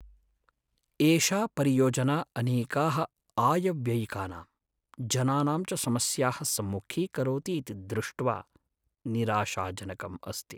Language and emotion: Sanskrit, sad